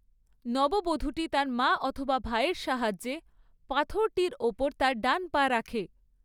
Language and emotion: Bengali, neutral